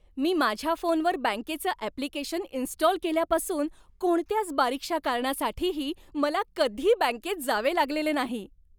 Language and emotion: Marathi, happy